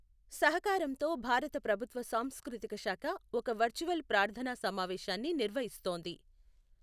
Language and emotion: Telugu, neutral